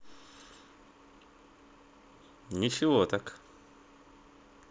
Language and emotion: Russian, neutral